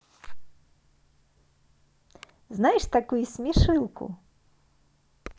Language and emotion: Russian, positive